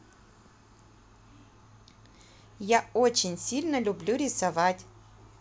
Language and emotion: Russian, positive